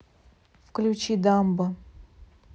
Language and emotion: Russian, neutral